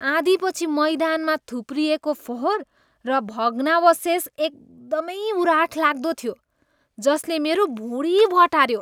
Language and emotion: Nepali, disgusted